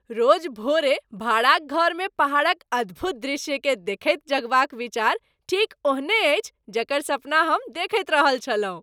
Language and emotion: Maithili, happy